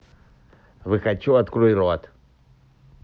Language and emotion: Russian, neutral